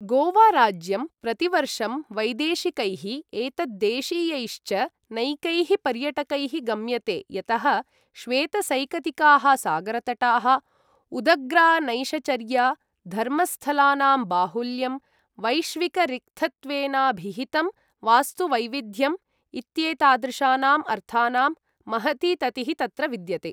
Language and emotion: Sanskrit, neutral